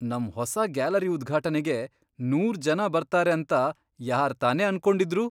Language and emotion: Kannada, surprised